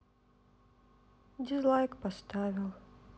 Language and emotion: Russian, sad